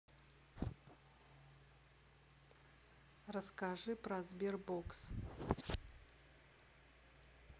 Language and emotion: Russian, neutral